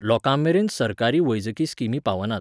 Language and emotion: Goan Konkani, neutral